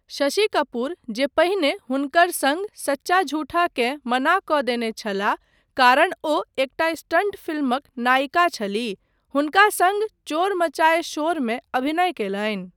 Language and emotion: Maithili, neutral